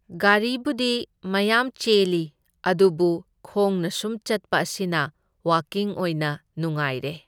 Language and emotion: Manipuri, neutral